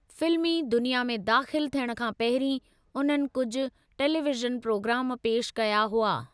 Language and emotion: Sindhi, neutral